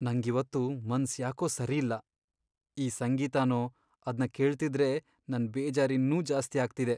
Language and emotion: Kannada, sad